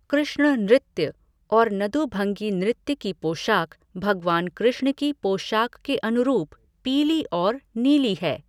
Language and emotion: Hindi, neutral